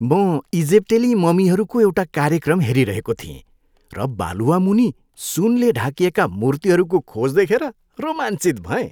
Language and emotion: Nepali, happy